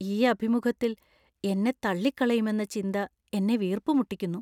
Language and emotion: Malayalam, fearful